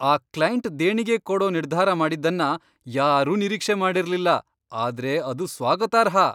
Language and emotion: Kannada, surprised